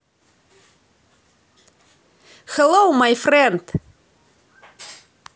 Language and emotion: Russian, positive